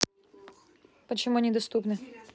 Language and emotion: Russian, neutral